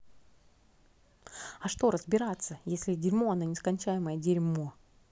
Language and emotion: Russian, angry